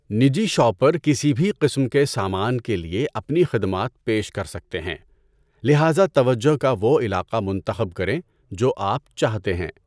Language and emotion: Urdu, neutral